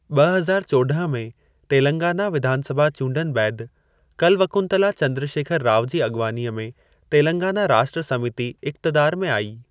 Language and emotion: Sindhi, neutral